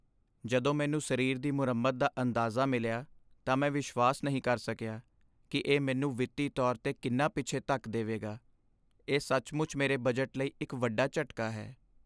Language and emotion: Punjabi, sad